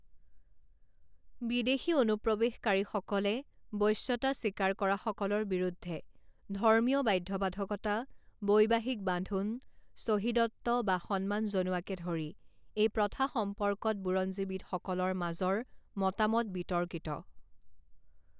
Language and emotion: Assamese, neutral